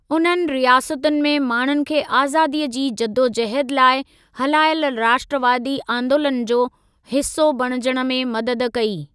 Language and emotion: Sindhi, neutral